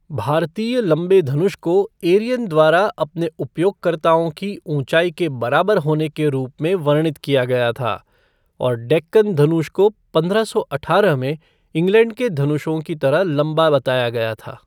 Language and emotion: Hindi, neutral